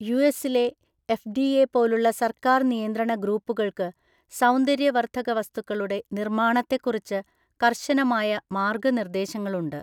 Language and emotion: Malayalam, neutral